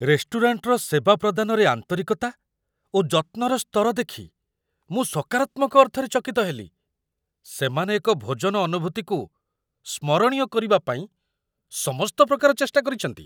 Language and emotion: Odia, surprised